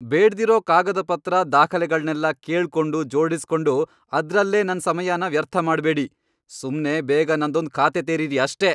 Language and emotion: Kannada, angry